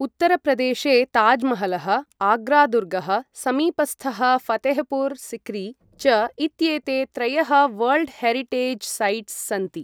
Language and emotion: Sanskrit, neutral